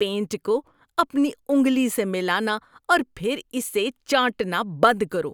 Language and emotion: Urdu, disgusted